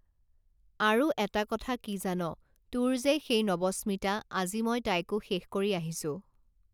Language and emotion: Assamese, neutral